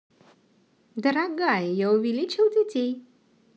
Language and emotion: Russian, positive